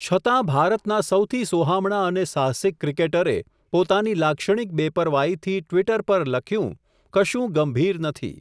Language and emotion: Gujarati, neutral